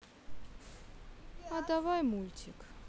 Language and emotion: Russian, sad